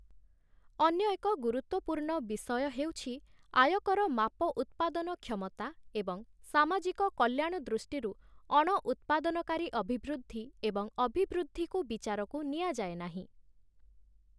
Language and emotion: Odia, neutral